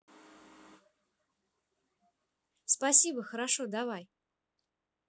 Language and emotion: Russian, positive